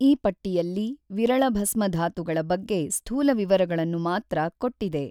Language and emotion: Kannada, neutral